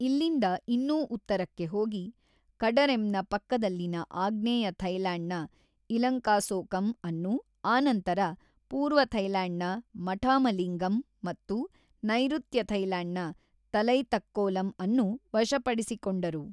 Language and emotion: Kannada, neutral